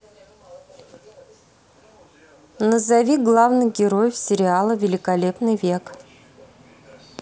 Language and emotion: Russian, neutral